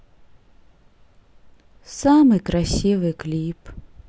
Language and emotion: Russian, sad